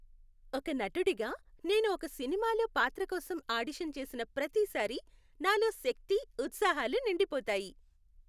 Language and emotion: Telugu, happy